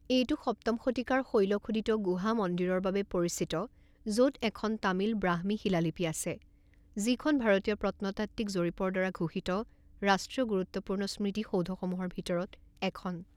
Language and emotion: Assamese, neutral